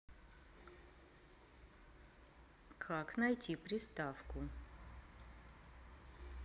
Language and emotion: Russian, neutral